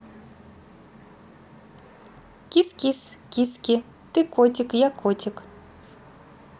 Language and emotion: Russian, positive